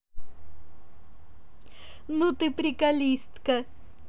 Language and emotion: Russian, positive